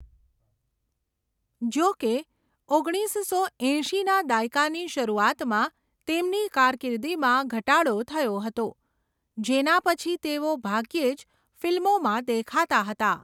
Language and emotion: Gujarati, neutral